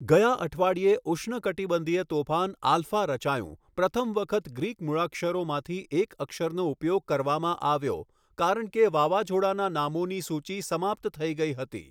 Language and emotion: Gujarati, neutral